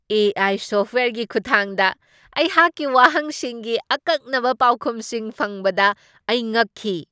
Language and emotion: Manipuri, surprised